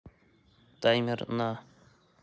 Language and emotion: Russian, neutral